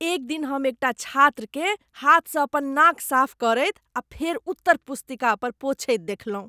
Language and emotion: Maithili, disgusted